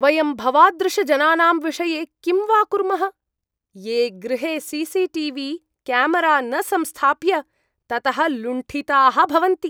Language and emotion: Sanskrit, disgusted